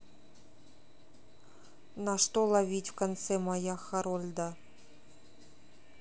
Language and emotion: Russian, neutral